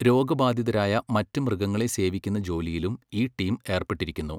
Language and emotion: Malayalam, neutral